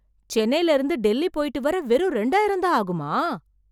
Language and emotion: Tamil, surprised